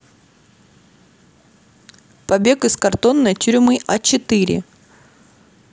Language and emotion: Russian, neutral